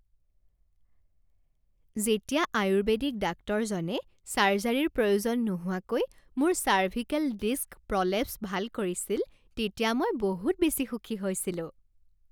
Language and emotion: Assamese, happy